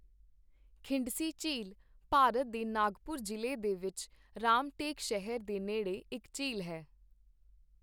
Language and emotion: Punjabi, neutral